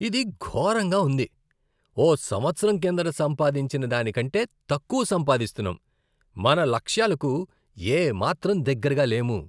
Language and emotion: Telugu, disgusted